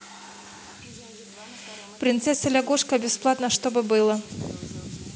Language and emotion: Russian, neutral